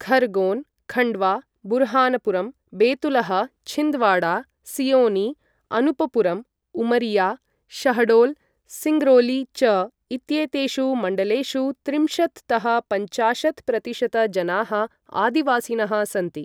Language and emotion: Sanskrit, neutral